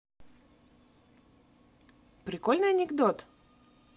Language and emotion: Russian, positive